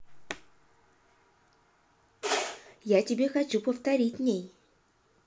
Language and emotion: Russian, neutral